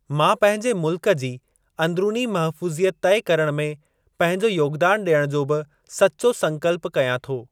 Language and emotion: Sindhi, neutral